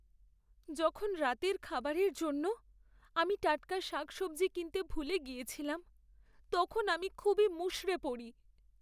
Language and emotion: Bengali, sad